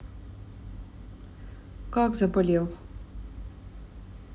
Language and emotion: Russian, neutral